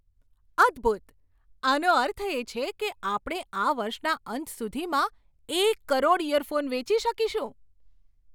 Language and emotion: Gujarati, surprised